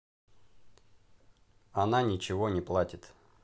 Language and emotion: Russian, neutral